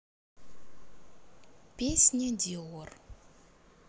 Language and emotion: Russian, neutral